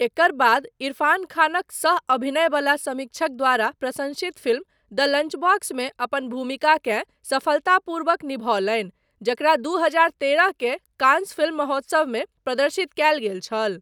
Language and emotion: Maithili, neutral